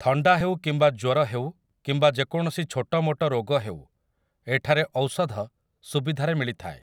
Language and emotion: Odia, neutral